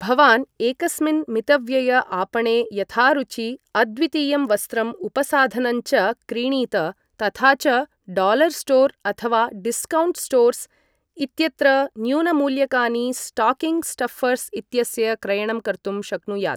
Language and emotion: Sanskrit, neutral